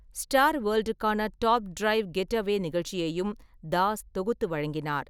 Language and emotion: Tamil, neutral